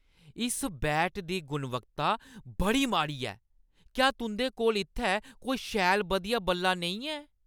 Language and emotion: Dogri, angry